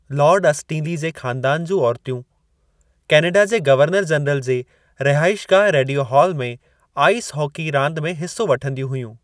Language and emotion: Sindhi, neutral